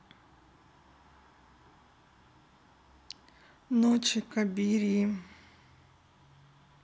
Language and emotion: Russian, sad